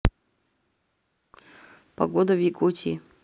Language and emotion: Russian, neutral